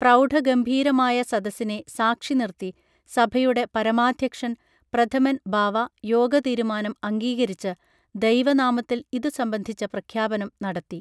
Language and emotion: Malayalam, neutral